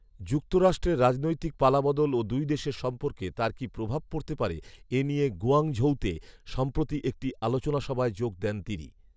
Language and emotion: Bengali, neutral